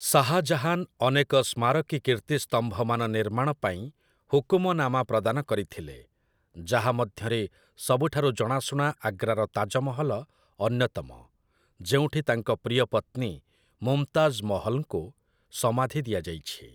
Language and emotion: Odia, neutral